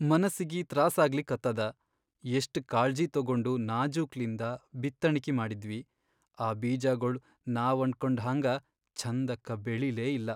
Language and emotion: Kannada, sad